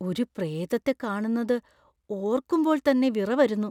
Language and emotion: Malayalam, fearful